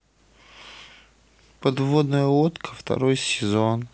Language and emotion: Russian, sad